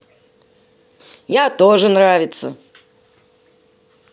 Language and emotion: Russian, positive